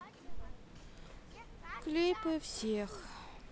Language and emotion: Russian, sad